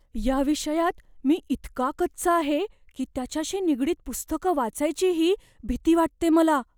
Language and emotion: Marathi, fearful